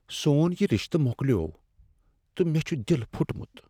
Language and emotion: Kashmiri, sad